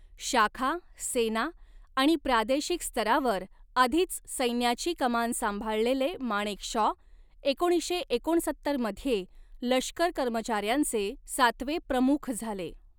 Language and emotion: Marathi, neutral